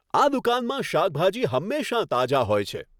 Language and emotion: Gujarati, happy